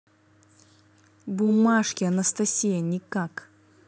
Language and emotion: Russian, neutral